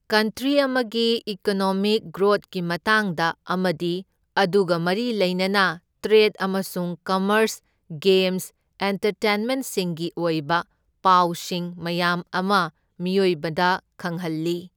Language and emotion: Manipuri, neutral